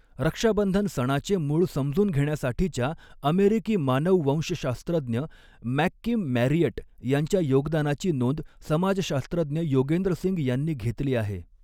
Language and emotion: Marathi, neutral